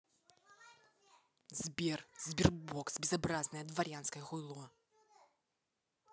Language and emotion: Russian, angry